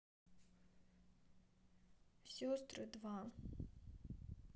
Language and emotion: Russian, sad